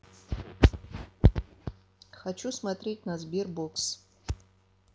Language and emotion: Russian, neutral